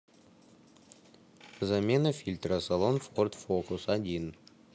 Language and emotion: Russian, neutral